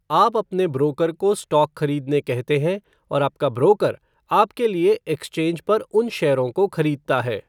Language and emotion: Hindi, neutral